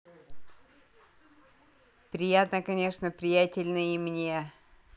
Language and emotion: Russian, positive